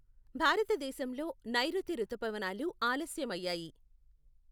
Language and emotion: Telugu, neutral